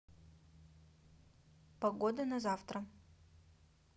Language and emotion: Russian, neutral